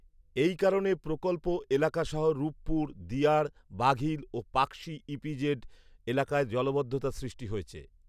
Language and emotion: Bengali, neutral